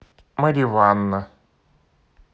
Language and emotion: Russian, neutral